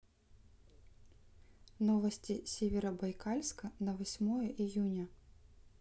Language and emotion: Russian, neutral